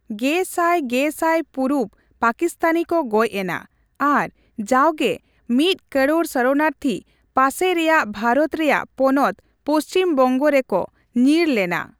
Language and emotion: Santali, neutral